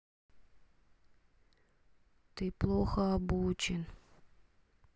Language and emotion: Russian, sad